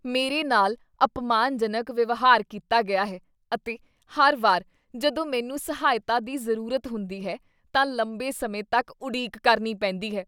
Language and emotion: Punjabi, disgusted